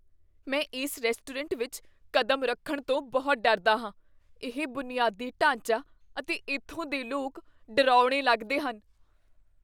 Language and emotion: Punjabi, fearful